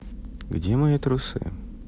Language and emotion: Russian, neutral